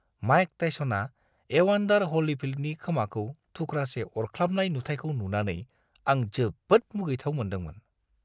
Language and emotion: Bodo, disgusted